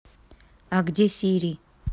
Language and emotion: Russian, neutral